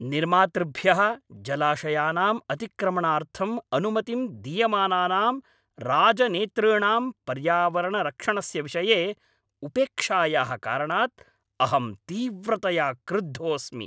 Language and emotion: Sanskrit, angry